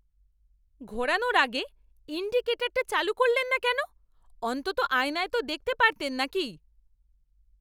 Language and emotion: Bengali, angry